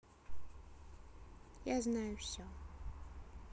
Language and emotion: Russian, neutral